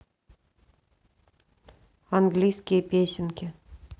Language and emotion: Russian, neutral